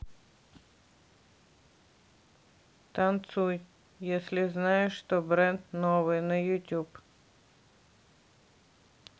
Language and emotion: Russian, neutral